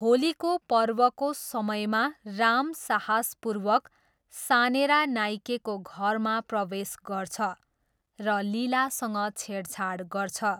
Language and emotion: Nepali, neutral